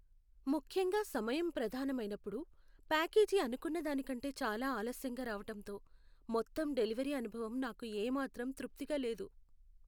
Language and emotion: Telugu, sad